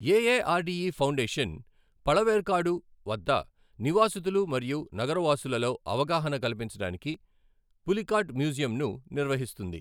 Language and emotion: Telugu, neutral